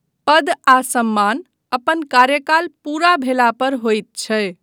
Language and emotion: Maithili, neutral